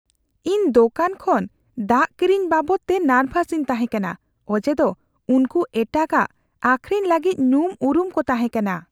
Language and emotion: Santali, fearful